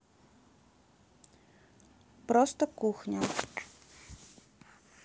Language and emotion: Russian, neutral